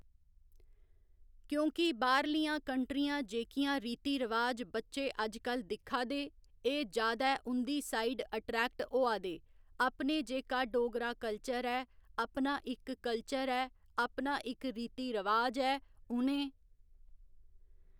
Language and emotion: Dogri, neutral